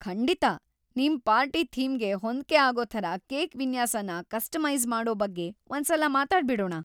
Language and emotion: Kannada, happy